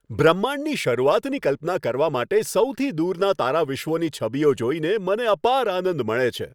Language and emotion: Gujarati, happy